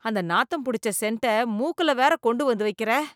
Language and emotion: Tamil, disgusted